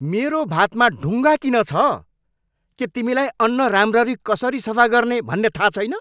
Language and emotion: Nepali, angry